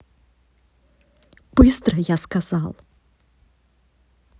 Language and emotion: Russian, angry